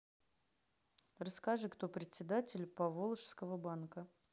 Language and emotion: Russian, neutral